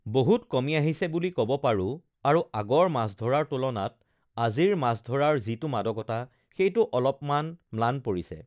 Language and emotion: Assamese, neutral